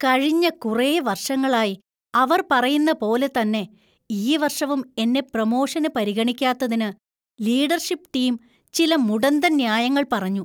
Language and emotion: Malayalam, disgusted